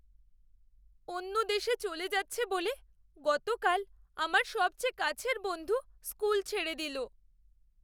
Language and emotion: Bengali, sad